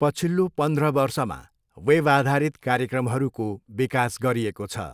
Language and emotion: Nepali, neutral